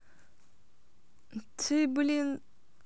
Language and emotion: Russian, neutral